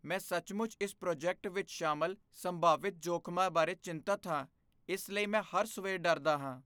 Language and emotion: Punjabi, fearful